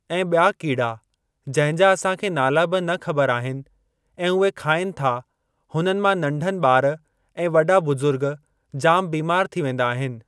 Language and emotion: Sindhi, neutral